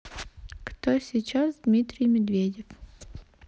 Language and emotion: Russian, neutral